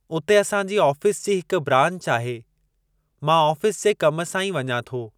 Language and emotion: Sindhi, neutral